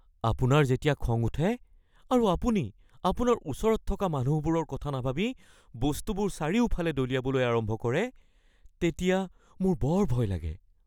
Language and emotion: Assamese, fearful